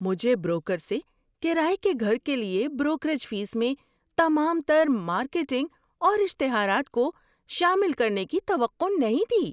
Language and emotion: Urdu, surprised